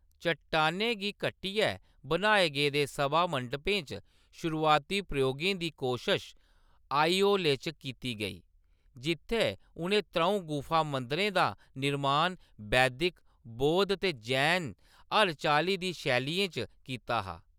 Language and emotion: Dogri, neutral